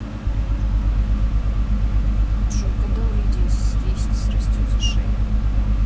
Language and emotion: Russian, neutral